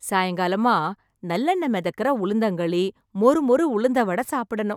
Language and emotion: Tamil, happy